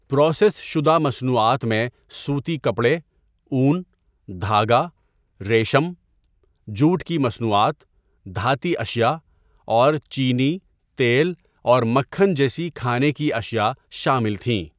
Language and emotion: Urdu, neutral